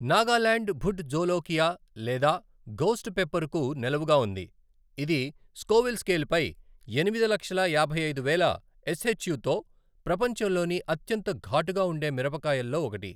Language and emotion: Telugu, neutral